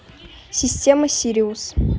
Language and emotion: Russian, neutral